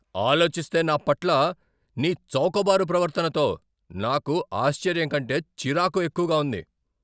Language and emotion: Telugu, angry